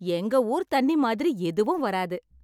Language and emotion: Tamil, happy